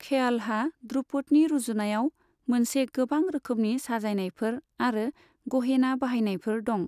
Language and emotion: Bodo, neutral